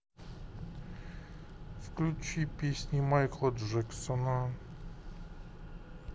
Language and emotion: Russian, sad